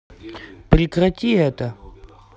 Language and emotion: Russian, angry